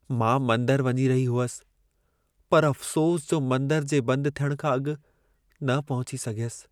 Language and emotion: Sindhi, sad